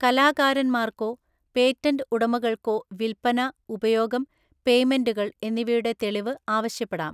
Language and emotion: Malayalam, neutral